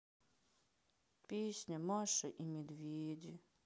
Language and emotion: Russian, sad